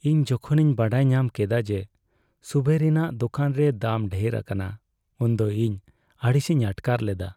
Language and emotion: Santali, sad